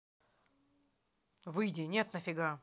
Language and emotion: Russian, angry